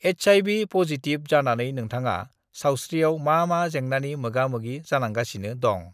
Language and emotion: Bodo, neutral